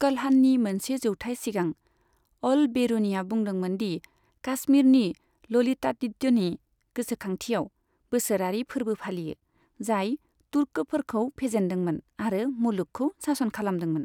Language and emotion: Bodo, neutral